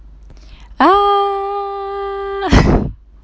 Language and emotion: Russian, positive